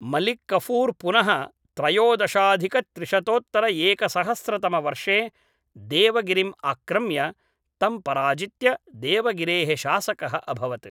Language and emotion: Sanskrit, neutral